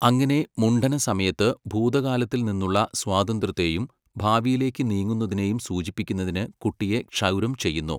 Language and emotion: Malayalam, neutral